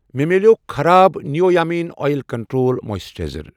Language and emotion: Kashmiri, neutral